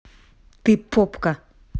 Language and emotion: Russian, neutral